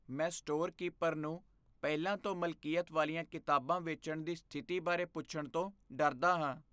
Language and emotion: Punjabi, fearful